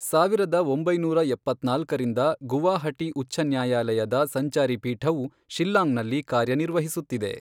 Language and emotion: Kannada, neutral